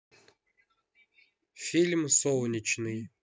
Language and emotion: Russian, neutral